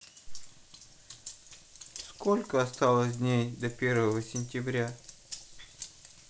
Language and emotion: Russian, sad